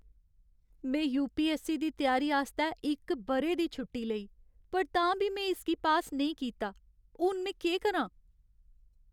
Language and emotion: Dogri, sad